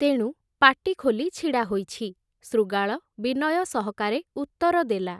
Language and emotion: Odia, neutral